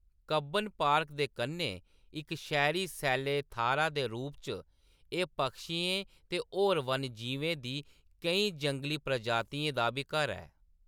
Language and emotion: Dogri, neutral